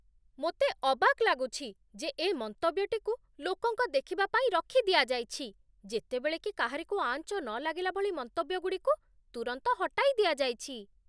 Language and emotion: Odia, surprised